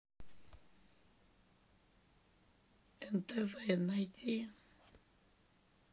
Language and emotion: Russian, sad